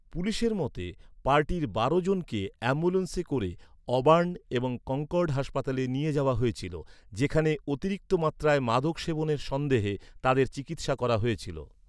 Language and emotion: Bengali, neutral